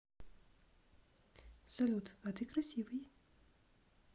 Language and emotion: Russian, neutral